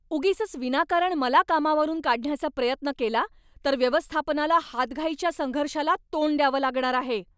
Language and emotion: Marathi, angry